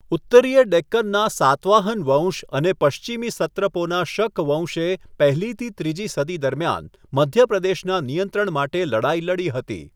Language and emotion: Gujarati, neutral